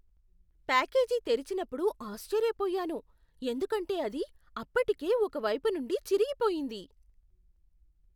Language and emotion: Telugu, surprised